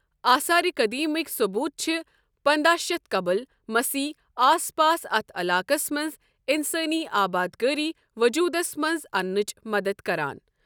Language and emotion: Kashmiri, neutral